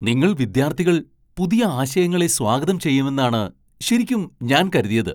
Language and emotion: Malayalam, surprised